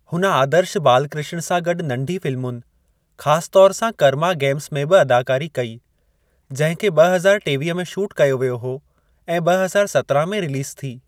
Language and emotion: Sindhi, neutral